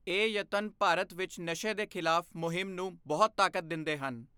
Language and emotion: Punjabi, neutral